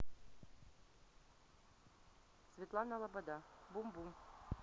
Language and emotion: Russian, neutral